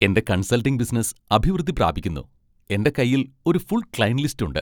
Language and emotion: Malayalam, happy